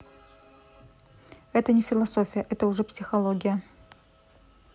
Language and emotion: Russian, neutral